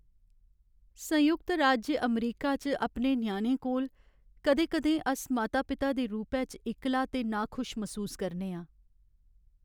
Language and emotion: Dogri, sad